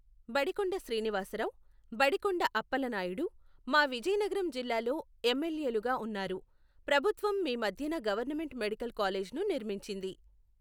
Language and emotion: Telugu, neutral